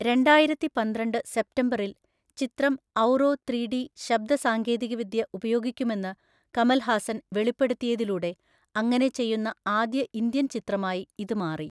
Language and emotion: Malayalam, neutral